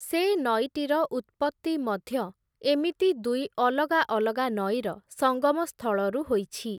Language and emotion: Odia, neutral